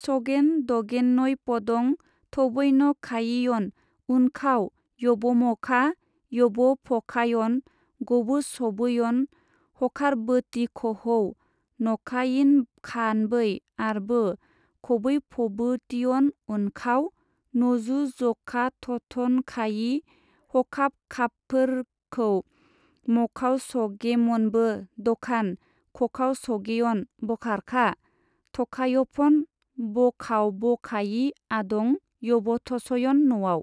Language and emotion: Bodo, neutral